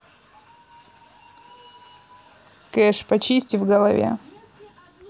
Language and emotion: Russian, neutral